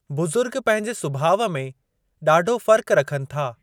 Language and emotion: Sindhi, neutral